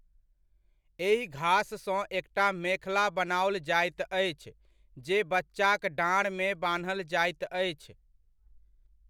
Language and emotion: Maithili, neutral